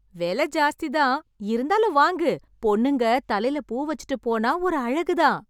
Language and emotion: Tamil, happy